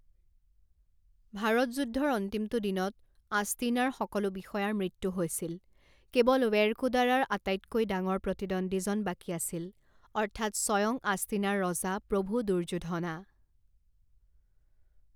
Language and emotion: Assamese, neutral